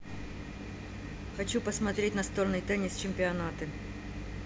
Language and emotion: Russian, neutral